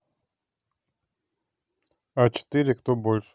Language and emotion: Russian, neutral